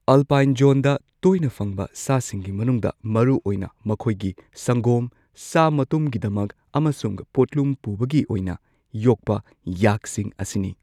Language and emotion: Manipuri, neutral